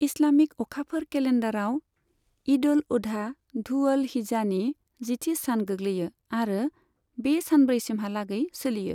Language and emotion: Bodo, neutral